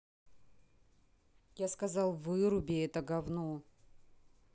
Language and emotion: Russian, angry